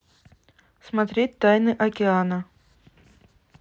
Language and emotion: Russian, neutral